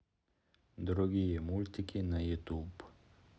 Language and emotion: Russian, neutral